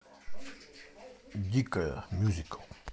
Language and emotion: Russian, neutral